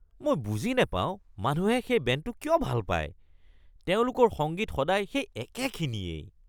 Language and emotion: Assamese, disgusted